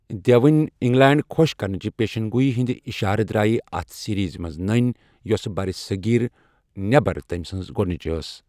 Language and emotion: Kashmiri, neutral